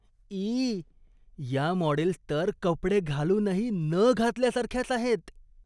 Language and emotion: Marathi, disgusted